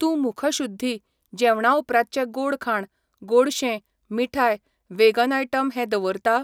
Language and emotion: Goan Konkani, neutral